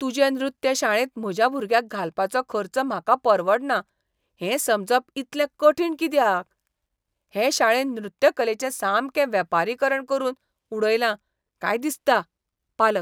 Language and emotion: Goan Konkani, disgusted